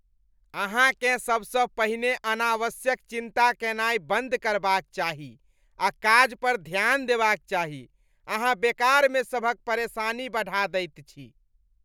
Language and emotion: Maithili, disgusted